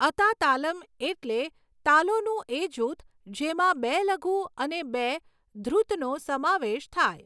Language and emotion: Gujarati, neutral